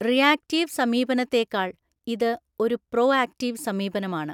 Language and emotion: Malayalam, neutral